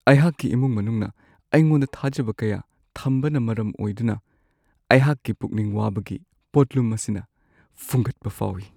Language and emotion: Manipuri, sad